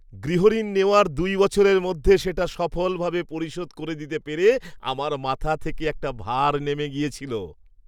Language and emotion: Bengali, happy